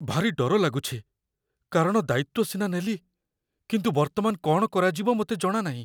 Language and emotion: Odia, fearful